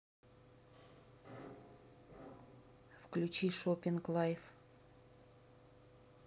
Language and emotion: Russian, neutral